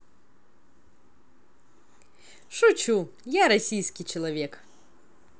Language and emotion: Russian, positive